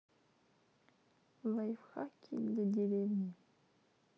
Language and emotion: Russian, neutral